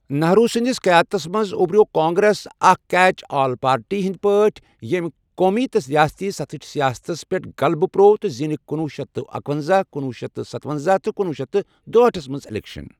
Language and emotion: Kashmiri, neutral